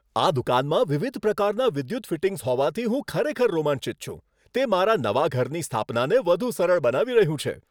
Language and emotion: Gujarati, happy